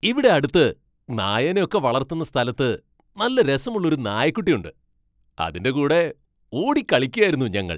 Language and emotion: Malayalam, happy